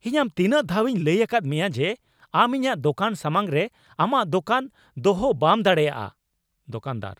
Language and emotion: Santali, angry